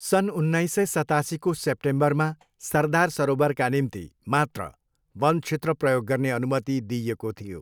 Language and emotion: Nepali, neutral